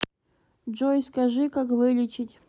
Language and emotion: Russian, neutral